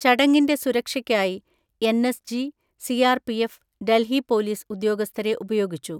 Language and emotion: Malayalam, neutral